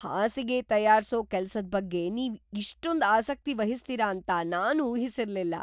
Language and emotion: Kannada, surprised